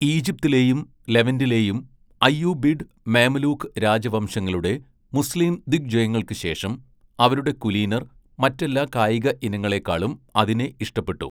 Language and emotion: Malayalam, neutral